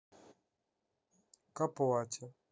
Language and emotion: Russian, neutral